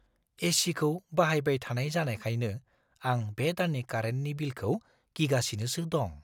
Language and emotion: Bodo, fearful